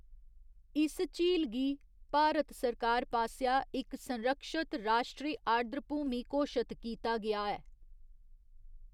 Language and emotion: Dogri, neutral